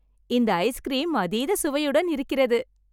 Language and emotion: Tamil, happy